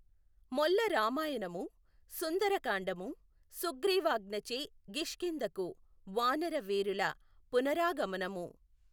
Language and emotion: Telugu, neutral